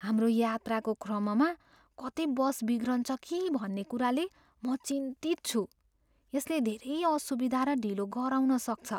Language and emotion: Nepali, fearful